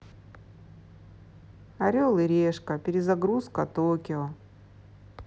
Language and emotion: Russian, sad